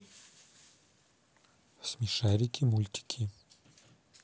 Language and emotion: Russian, neutral